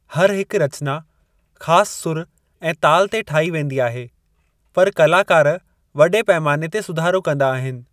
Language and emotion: Sindhi, neutral